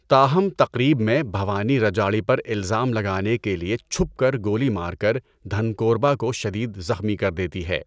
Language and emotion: Urdu, neutral